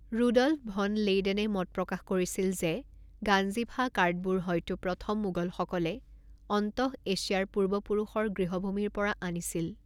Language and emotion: Assamese, neutral